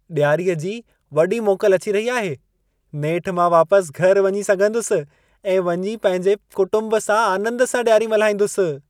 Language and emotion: Sindhi, happy